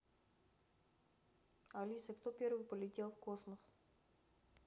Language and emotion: Russian, neutral